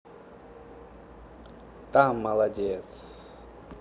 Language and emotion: Russian, positive